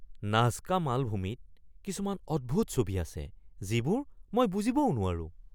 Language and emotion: Assamese, surprised